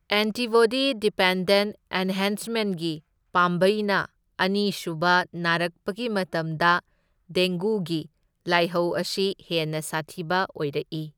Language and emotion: Manipuri, neutral